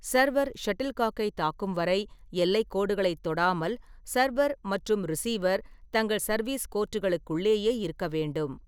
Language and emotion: Tamil, neutral